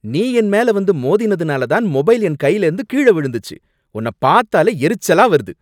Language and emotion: Tamil, angry